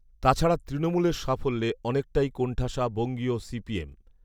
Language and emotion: Bengali, neutral